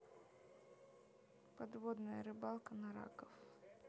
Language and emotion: Russian, neutral